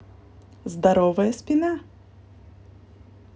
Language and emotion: Russian, positive